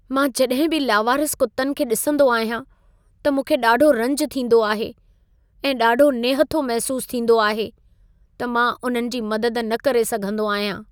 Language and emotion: Sindhi, sad